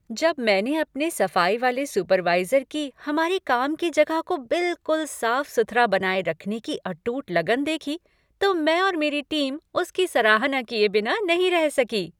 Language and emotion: Hindi, happy